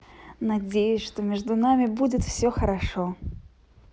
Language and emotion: Russian, positive